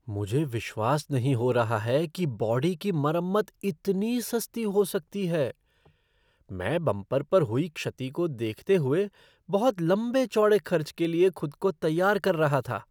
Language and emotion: Hindi, surprised